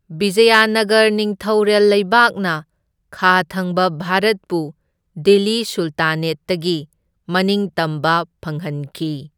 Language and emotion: Manipuri, neutral